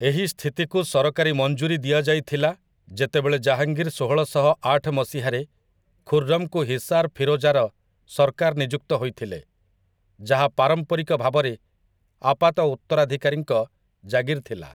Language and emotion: Odia, neutral